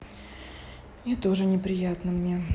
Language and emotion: Russian, sad